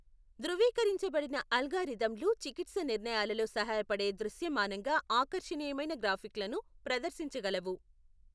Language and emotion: Telugu, neutral